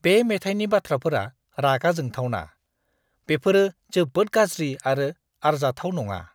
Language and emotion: Bodo, disgusted